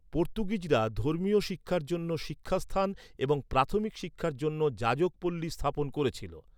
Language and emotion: Bengali, neutral